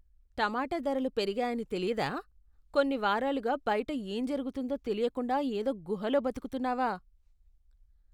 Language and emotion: Telugu, disgusted